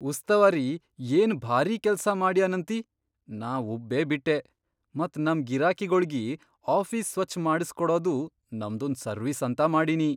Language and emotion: Kannada, surprised